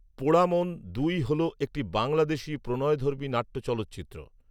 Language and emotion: Bengali, neutral